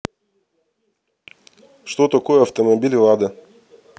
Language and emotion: Russian, neutral